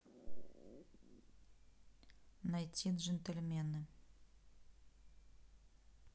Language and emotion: Russian, neutral